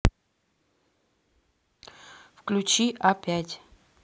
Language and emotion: Russian, neutral